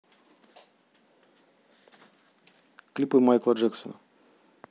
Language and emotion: Russian, neutral